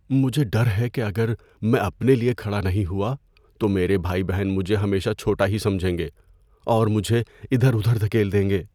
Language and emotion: Urdu, fearful